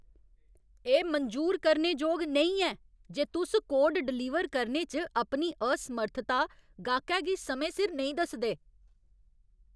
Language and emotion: Dogri, angry